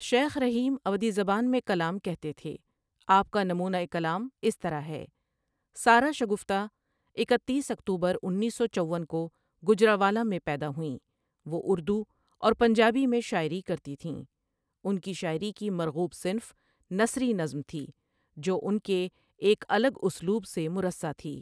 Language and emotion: Urdu, neutral